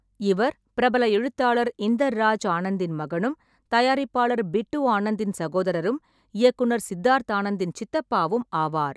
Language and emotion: Tamil, neutral